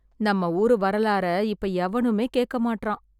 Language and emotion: Tamil, sad